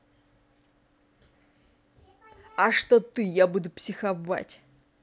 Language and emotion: Russian, angry